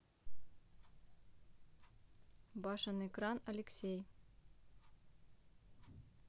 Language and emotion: Russian, neutral